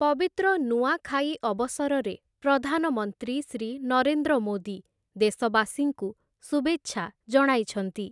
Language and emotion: Odia, neutral